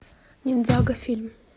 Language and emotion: Russian, neutral